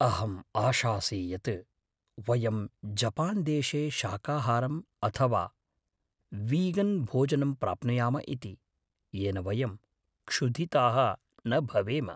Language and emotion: Sanskrit, fearful